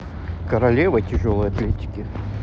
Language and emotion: Russian, neutral